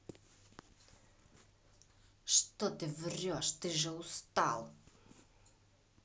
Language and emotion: Russian, angry